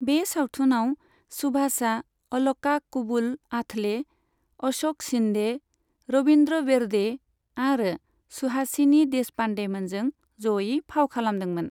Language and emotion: Bodo, neutral